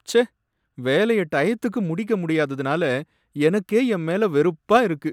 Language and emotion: Tamil, sad